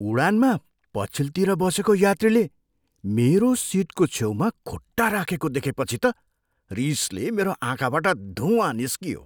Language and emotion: Nepali, surprised